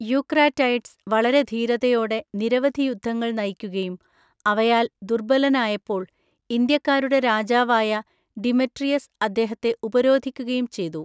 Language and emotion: Malayalam, neutral